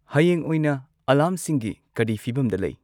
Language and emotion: Manipuri, neutral